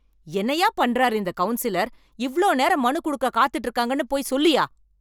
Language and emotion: Tamil, angry